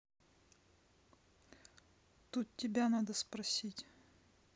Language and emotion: Russian, neutral